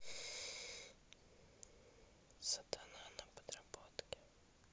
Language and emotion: Russian, neutral